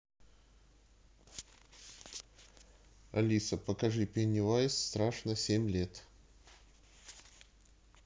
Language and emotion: Russian, neutral